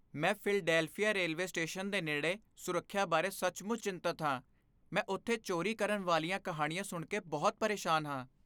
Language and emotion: Punjabi, fearful